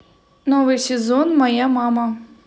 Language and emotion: Russian, neutral